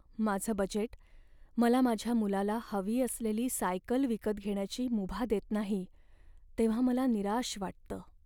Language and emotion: Marathi, sad